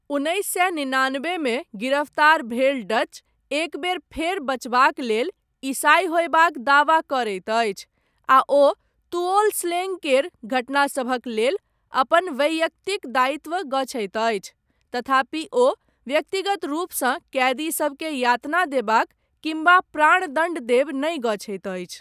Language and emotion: Maithili, neutral